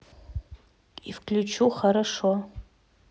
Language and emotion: Russian, neutral